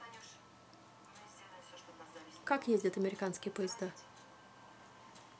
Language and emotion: Russian, neutral